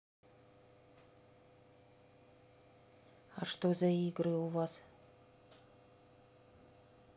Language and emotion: Russian, neutral